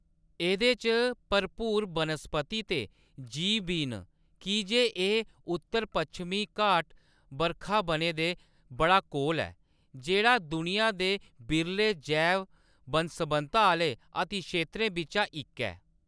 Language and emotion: Dogri, neutral